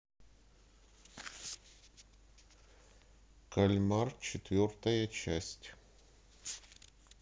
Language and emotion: Russian, neutral